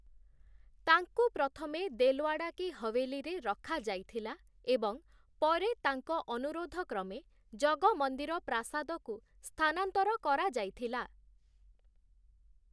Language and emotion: Odia, neutral